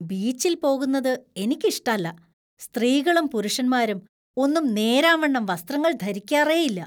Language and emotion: Malayalam, disgusted